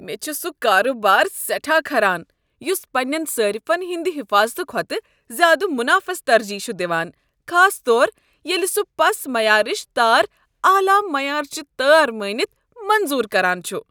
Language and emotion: Kashmiri, disgusted